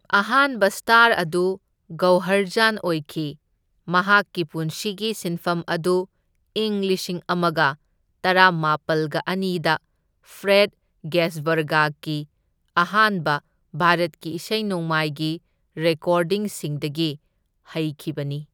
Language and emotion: Manipuri, neutral